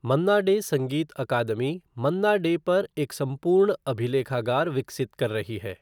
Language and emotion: Hindi, neutral